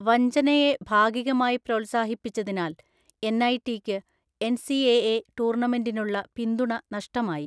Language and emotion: Malayalam, neutral